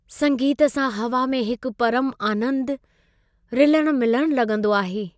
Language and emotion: Sindhi, happy